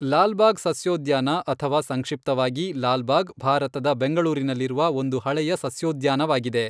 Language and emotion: Kannada, neutral